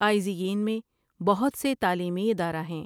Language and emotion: Urdu, neutral